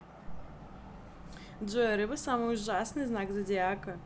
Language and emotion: Russian, positive